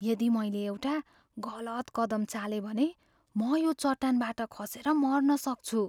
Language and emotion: Nepali, fearful